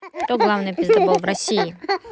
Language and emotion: Russian, neutral